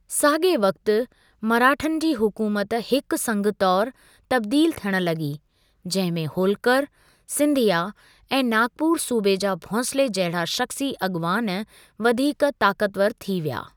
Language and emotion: Sindhi, neutral